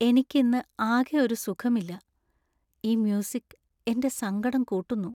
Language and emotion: Malayalam, sad